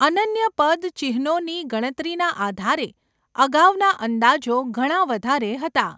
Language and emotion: Gujarati, neutral